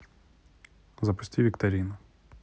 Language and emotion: Russian, neutral